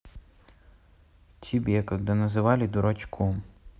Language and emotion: Russian, neutral